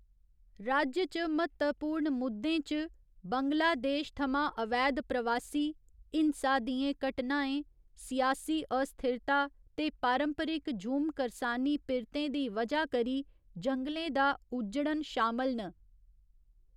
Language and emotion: Dogri, neutral